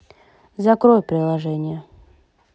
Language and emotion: Russian, neutral